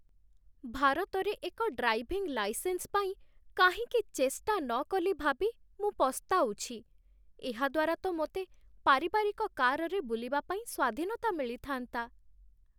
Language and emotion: Odia, sad